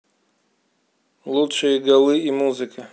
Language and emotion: Russian, neutral